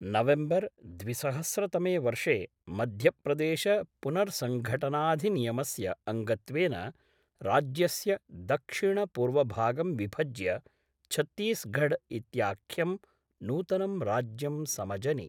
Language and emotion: Sanskrit, neutral